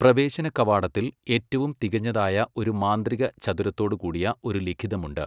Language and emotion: Malayalam, neutral